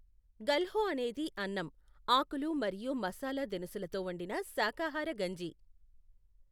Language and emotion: Telugu, neutral